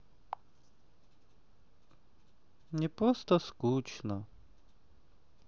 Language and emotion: Russian, sad